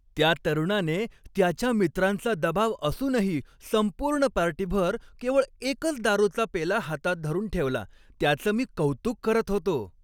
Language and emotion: Marathi, happy